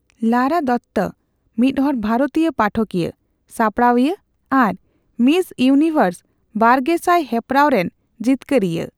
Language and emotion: Santali, neutral